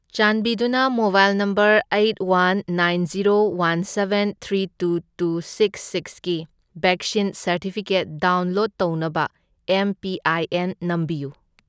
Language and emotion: Manipuri, neutral